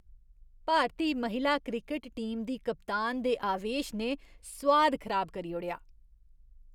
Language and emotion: Dogri, disgusted